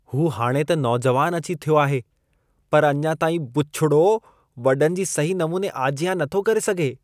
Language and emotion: Sindhi, disgusted